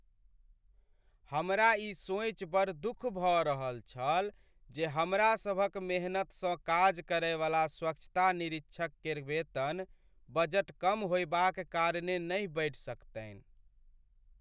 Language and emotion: Maithili, sad